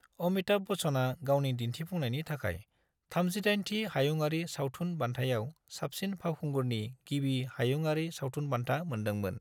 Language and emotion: Bodo, neutral